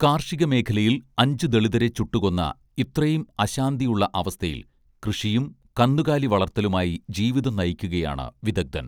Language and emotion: Malayalam, neutral